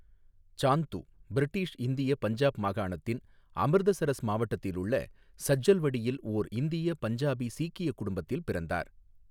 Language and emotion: Tamil, neutral